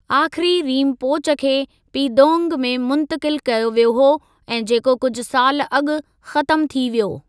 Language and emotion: Sindhi, neutral